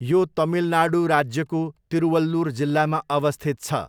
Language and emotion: Nepali, neutral